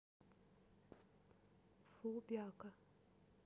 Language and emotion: Russian, neutral